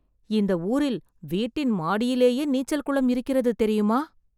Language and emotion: Tamil, surprised